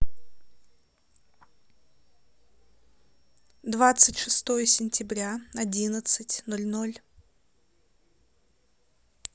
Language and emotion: Russian, neutral